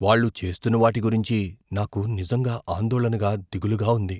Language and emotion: Telugu, fearful